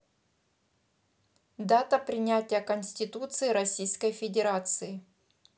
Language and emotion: Russian, neutral